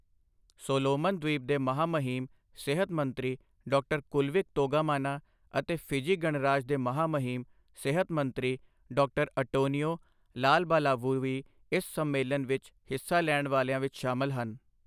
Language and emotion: Punjabi, neutral